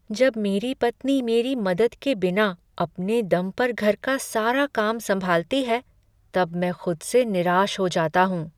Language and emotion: Hindi, sad